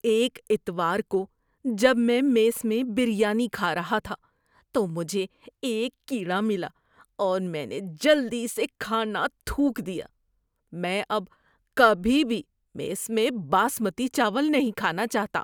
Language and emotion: Urdu, disgusted